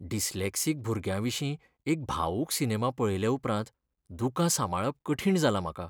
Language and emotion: Goan Konkani, sad